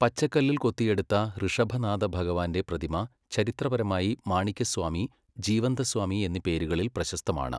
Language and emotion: Malayalam, neutral